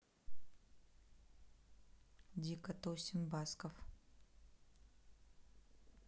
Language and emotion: Russian, neutral